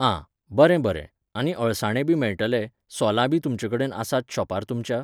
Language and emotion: Goan Konkani, neutral